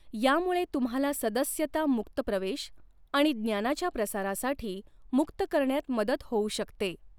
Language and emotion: Marathi, neutral